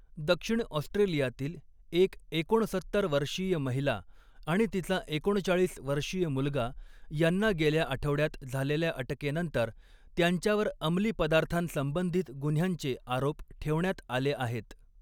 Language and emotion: Marathi, neutral